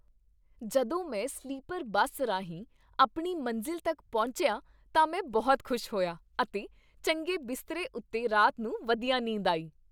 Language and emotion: Punjabi, happy